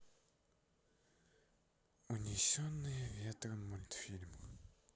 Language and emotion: Russian, sad